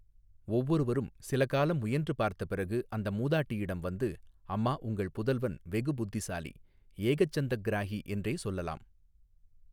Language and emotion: Tamil, neutral